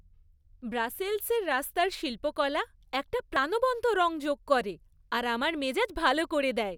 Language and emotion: Bengali, happy